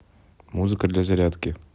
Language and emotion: Russian, neutral